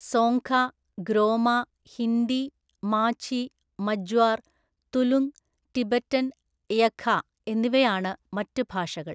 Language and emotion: Malayalam, neutral